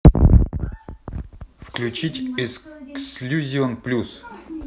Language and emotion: Russian, neutral